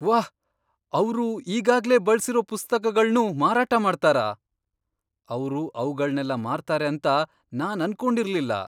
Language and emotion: Kannada, surprised